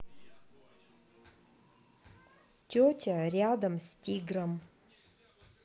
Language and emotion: Russian, neutral